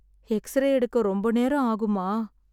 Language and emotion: Tamil, sad